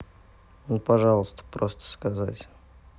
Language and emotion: Russian, sad